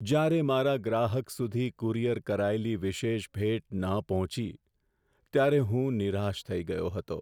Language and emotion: Gujarati, sad